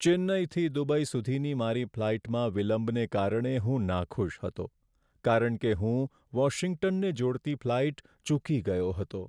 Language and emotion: Gujarati, sad